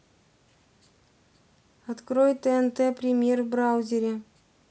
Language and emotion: Russian, neutral